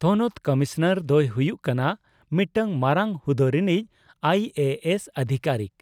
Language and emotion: Santali, neutral